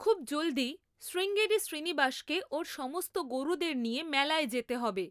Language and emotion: Bengali, neutral